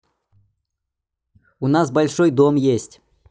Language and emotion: Russian, neutral